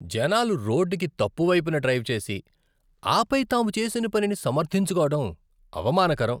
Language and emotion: Telugu, disgusted